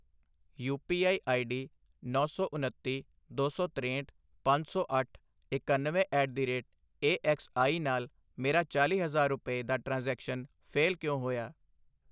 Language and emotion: Punjabi, neutral